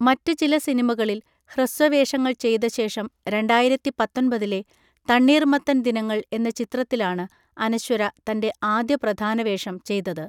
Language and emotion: Malayalam, neutral